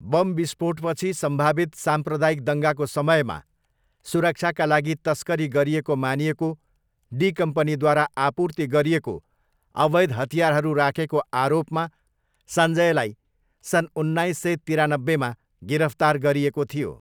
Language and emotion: Nepali, neutral